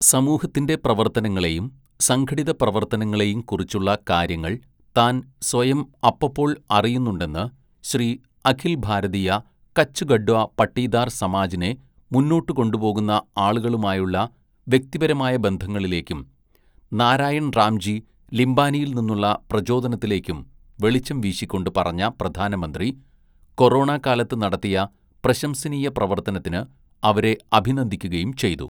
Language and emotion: Malayalam, neutral